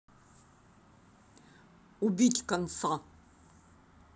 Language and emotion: Russian, angry